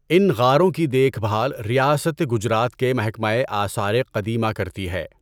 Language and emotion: Urdu, neutral